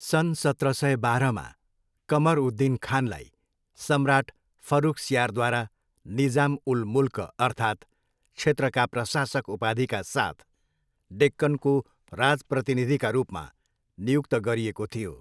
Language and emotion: Nepali, neutral